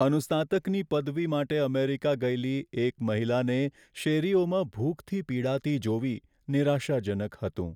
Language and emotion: Gujarati, sad